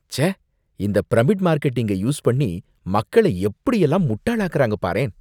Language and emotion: Tamil, disgusted